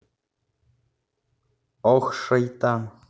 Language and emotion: Russian, neutral